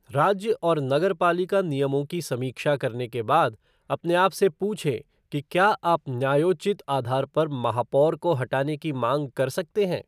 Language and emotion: Hindi, neutral